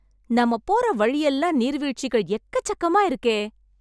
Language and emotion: Tamil, happy